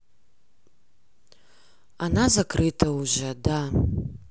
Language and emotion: Russian, neutral